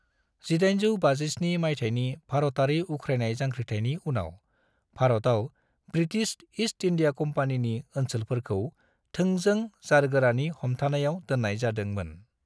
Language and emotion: Bodo, neutral